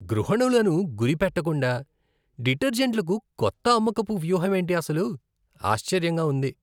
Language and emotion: Telugu, disgusted